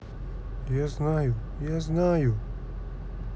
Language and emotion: Russian, sad